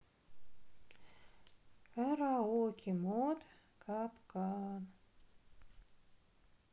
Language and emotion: Russian, sad